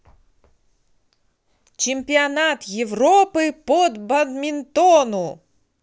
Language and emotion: Russian, positive